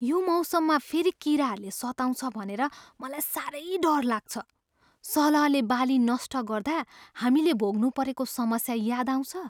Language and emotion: Nepali, fearful